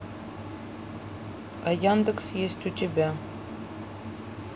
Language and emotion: Russian, neutral